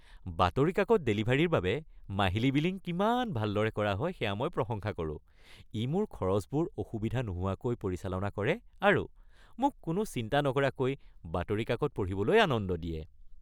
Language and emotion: Assamese, happy